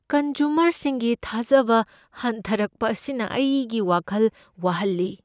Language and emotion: Manipuri, fearful